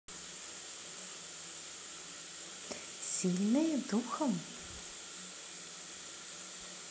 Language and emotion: Russian, positive